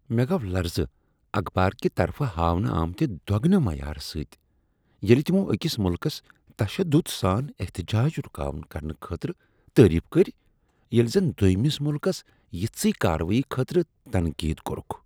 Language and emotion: Kashmiri, disgusted